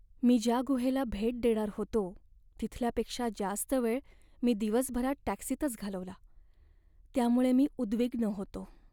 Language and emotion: Marathi, sad